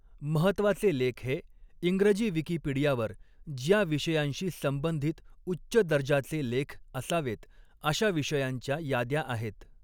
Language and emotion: Marathi, neutral